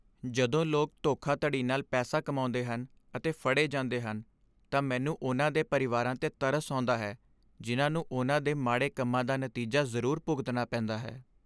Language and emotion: Punjabi, sad